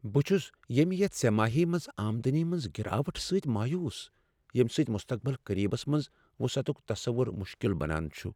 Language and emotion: Kashmiri, sad